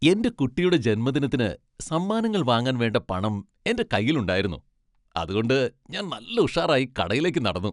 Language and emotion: Malayalam, happy